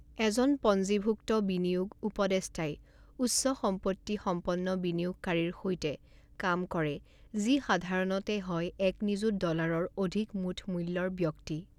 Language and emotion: Assamese, neutral